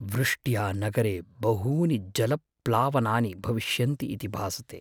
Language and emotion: Sanskrit, fearful